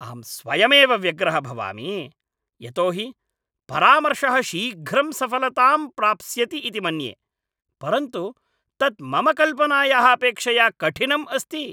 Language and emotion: Sanskrit, angry